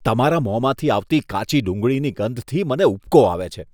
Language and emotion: Gujarati, disgusted